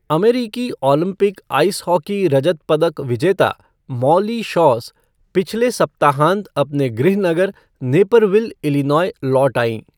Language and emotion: Hindi, neutral